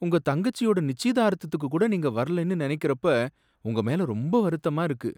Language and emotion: Tamil, sad